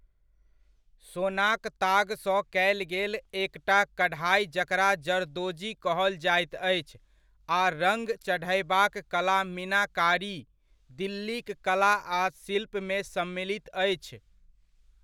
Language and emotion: Maithili, neutral